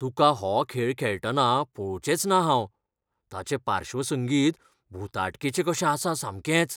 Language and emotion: Goan Konkani, fearful